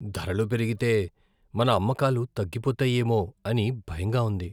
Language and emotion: Telugu, fearful